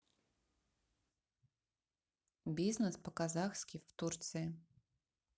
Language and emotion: Russian, neutral